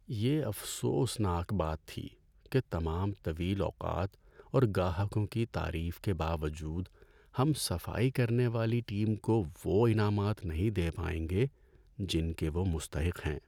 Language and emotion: Urdu, sad